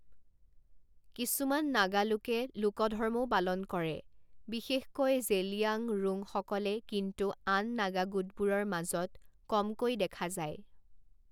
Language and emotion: Assamese, neutral